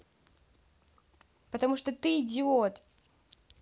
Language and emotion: Russian, angry